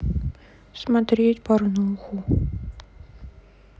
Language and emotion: Russian, sad